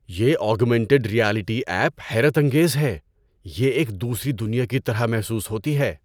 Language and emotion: Urdu, surprised